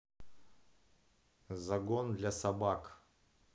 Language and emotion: Russian, neutral